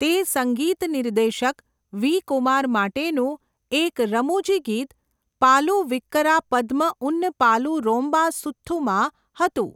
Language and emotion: Gujarati, neutral